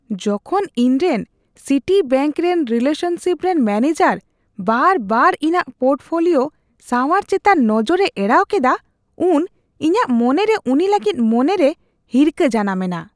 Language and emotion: Santali, disgusted